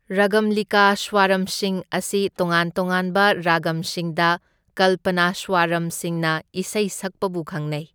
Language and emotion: Manipuri, neutral